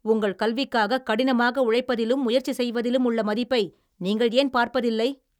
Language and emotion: Tamil, angry